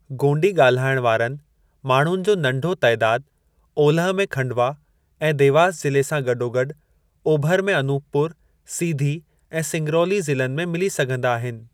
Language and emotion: Sindhi, neutral